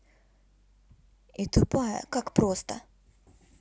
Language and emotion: Russian, neutral